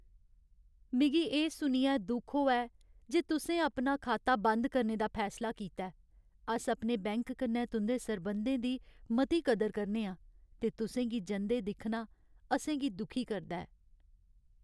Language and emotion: Dogri, sad